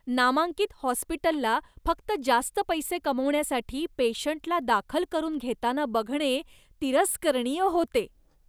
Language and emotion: Marathi, disgusted